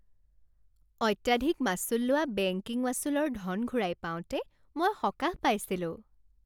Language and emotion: Assamese, happy